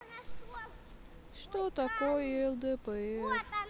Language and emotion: Russian, sad